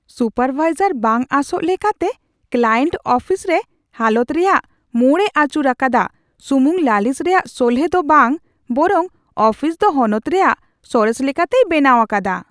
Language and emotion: Santali, surprised